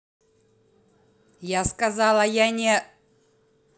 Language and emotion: Russian, angry